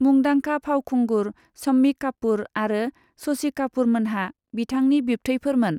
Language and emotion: Bodo, neutral